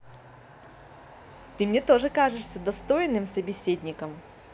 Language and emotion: Russian, positive